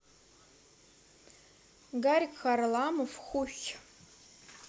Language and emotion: Russian, neutral